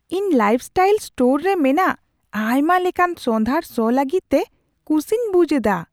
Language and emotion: Santali, surprised